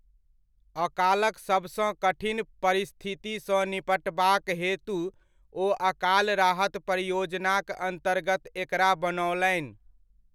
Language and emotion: Maithili, neutral